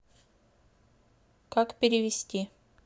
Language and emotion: Russian, neutral